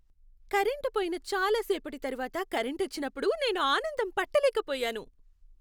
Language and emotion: Telugu, happy